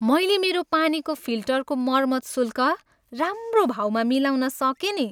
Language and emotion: Nepali, happy